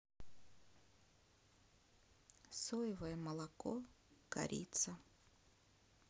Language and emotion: Russian, sad